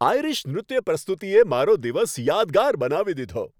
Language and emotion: Gujarati, happy